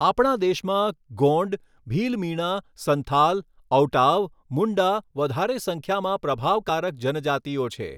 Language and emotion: Gujarati, neutral